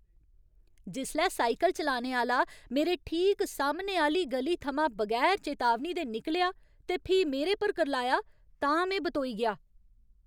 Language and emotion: Dogri, angry